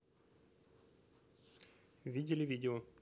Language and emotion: Russian, neutral